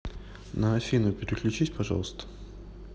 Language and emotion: Russian, neutral